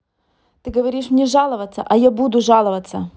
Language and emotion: Russian, angry